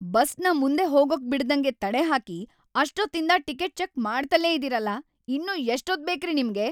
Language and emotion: Kannada, angry